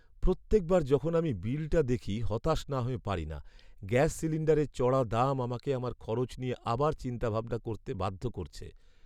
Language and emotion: Bengali, sad